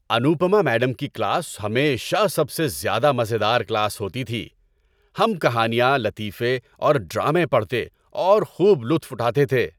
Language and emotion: Urdu, happy